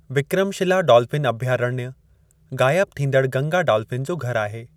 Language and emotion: Sindhi, neutral